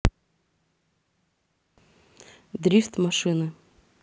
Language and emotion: Russian, neutral